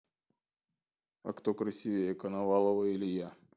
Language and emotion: Russian, neutral